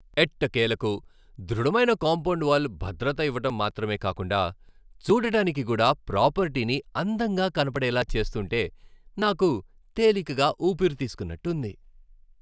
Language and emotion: Telugu, happy